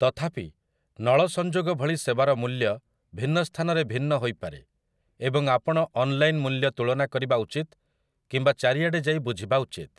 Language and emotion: Odia, neutral